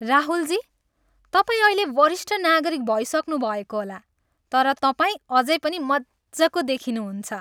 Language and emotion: Nepali, happy